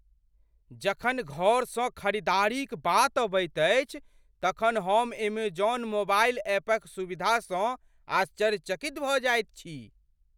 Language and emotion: Maithili, surprised